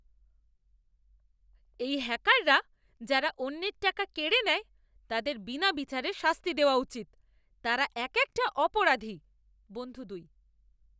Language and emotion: Bengali, angry